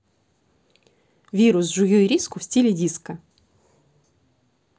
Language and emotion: Russian, neutral